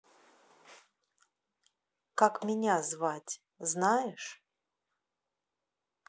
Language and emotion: Russian, neutral